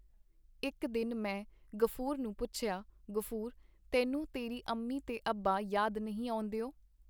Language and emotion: Punjabi, neutral